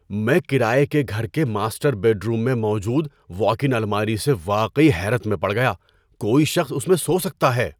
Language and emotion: Urdu, surprised